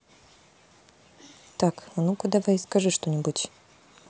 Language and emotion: Russian, neutral